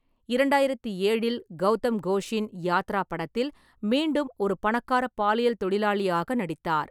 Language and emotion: Tamil, neutral